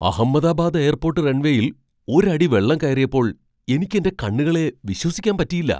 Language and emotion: Malayalam, surprised